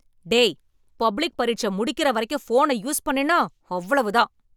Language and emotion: Tamil, angry